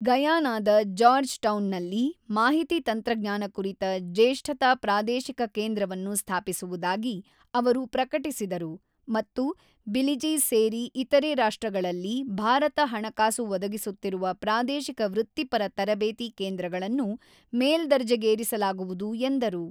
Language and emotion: Kannada, neutral